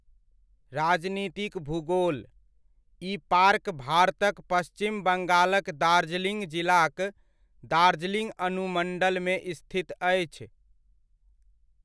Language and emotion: Maithili, neutral